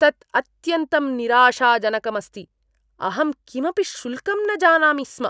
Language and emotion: Sanskrit, disgusted